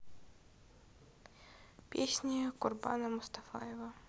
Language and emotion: Russian, neutral